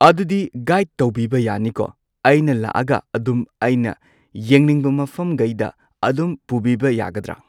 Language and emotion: Manipuri, neutral